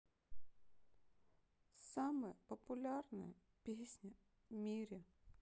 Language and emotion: Russian, sad